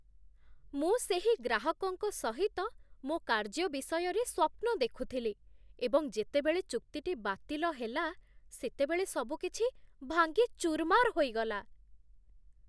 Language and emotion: Odia, surprised